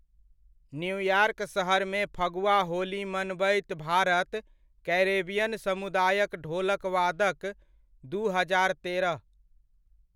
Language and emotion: Maithili, neutral